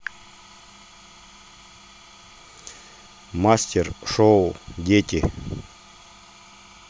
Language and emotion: Russian, neutral